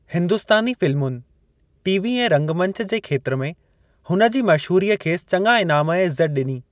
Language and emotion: Sindhi, neutral